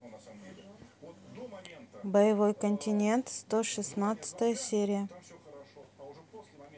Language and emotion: Russian, neutral